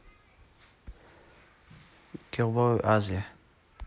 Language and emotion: Russian, neutral